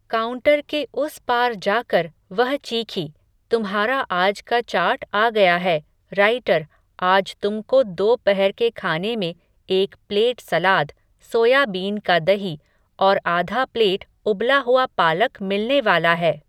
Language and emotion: Hindi, neutral